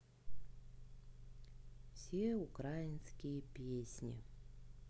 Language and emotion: Russian, sad